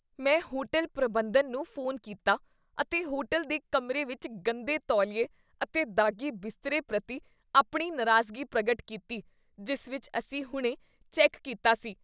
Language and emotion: Punjabi, disgusted